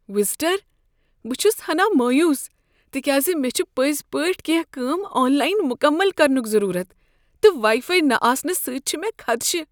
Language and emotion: Kashmiri, fearful